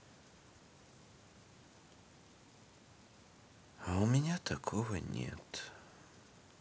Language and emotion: Russian, sad